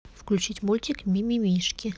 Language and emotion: Russian, neutral